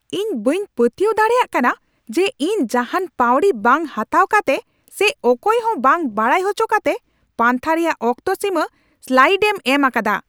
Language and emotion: Santali, angry